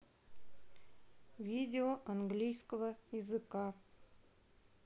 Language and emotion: Russian, neutral